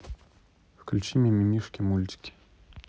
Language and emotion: Russian, neutral